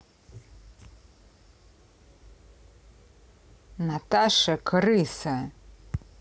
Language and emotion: Russian, angry